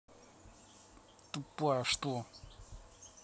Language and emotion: Russian, angry